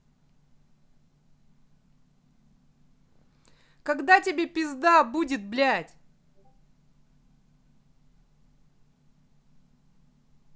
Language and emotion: Russian, angry